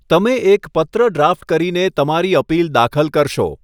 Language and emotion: Gujarati, neutral